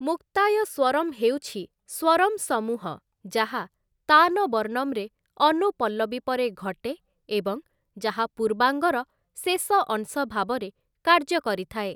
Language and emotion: Odia, neutral